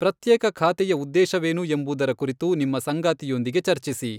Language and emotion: Kannada, neutral